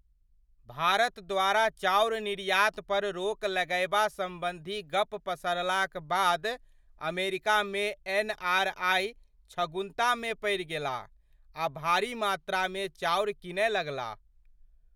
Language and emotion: Maithili, surprised